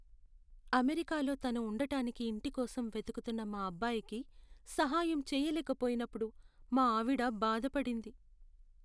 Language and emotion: Telugu, sad